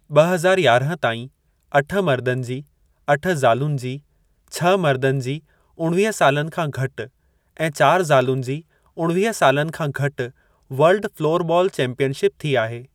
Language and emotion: Sindhi, neutral